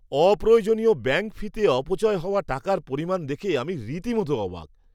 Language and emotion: Bengali, surprised